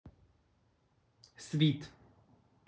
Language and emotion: Russian, neutral